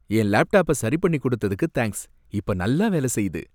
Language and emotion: Tamil, happy